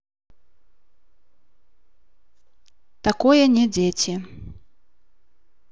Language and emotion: Russian, neutral